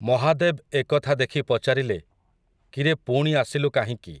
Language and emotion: Odia, neutral